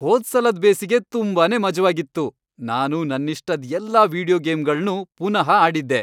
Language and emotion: Kannada, happy